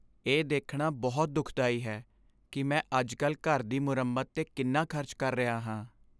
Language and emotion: Punjabi, sad